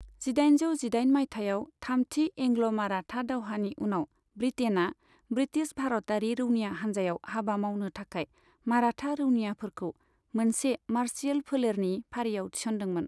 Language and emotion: Bodo, neutral